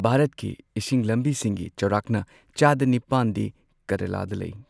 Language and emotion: Manipuri, neutral